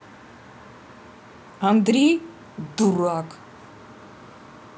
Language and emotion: Russian, angry